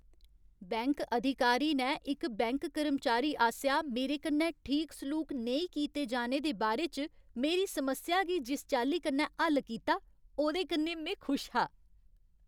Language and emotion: Dogri, happy